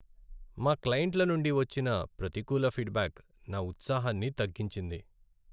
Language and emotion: Telugu, sad